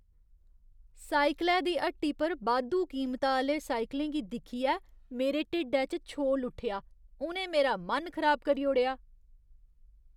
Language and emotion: Dogri, disgusted